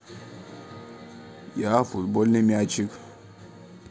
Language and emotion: Russian, neutral